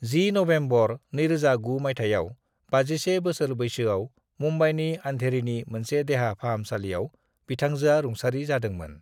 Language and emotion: Bodo, neutral